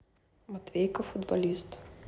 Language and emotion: Russian, neutral